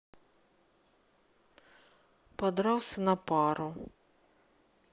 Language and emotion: Russian, neutral